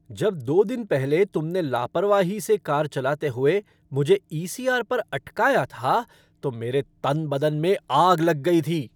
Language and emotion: Hindi, angry